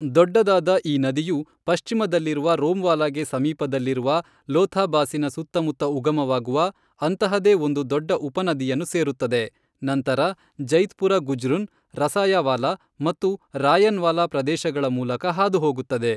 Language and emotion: Kannada, neutral